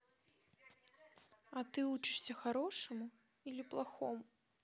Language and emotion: Russian, neutral